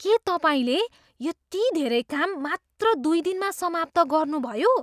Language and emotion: Nepali, surprised